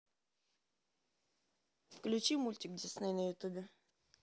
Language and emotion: Russian, neutral